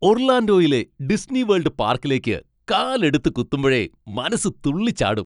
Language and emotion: Malayalam, happy